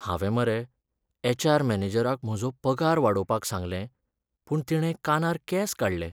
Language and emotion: Goan Konkani, sad